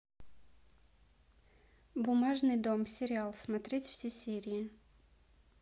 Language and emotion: Russian, neutral